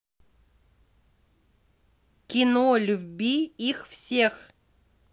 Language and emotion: Russian, neutral